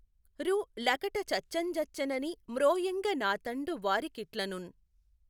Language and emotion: Telugu, neutral